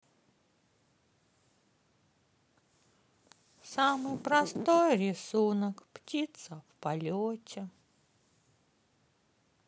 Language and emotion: Russian, sad